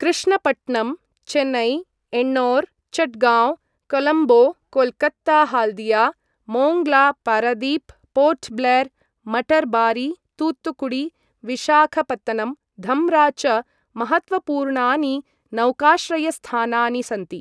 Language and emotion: Sanskrit, neutral